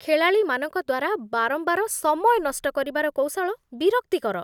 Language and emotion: Odia, disgusted